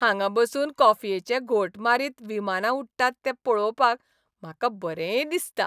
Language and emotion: Goan Konkani, happy